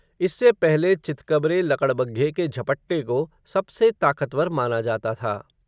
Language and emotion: Hindi, neutral